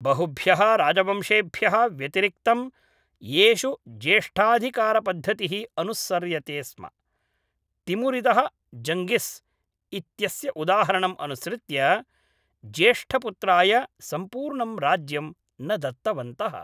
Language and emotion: Sanskrit, neutral